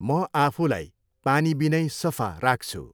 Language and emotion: Nepali, neutral